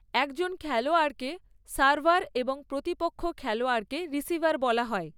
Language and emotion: Bengali, neutral